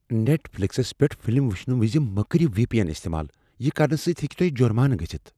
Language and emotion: Kashmiri, fearful